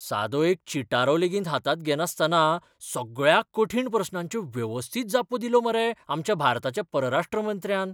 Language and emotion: Goan Konkani, surprised